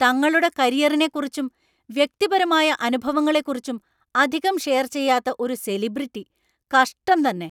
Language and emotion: Malayalam, angry